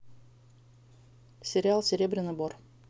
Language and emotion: Russian, neutral